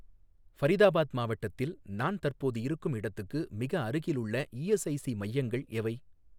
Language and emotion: Tamil, neutral